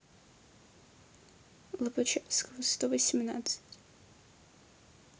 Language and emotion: Russian, sad